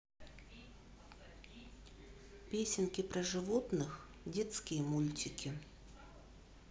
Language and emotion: Russian, neutral